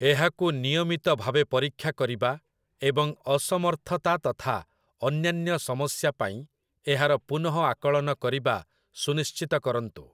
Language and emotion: Odia, neutral